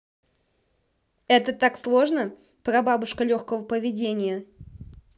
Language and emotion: Russian, angry